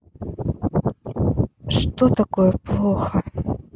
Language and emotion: Russian, sad